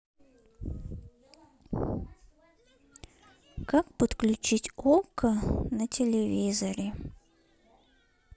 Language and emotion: Russian, neutral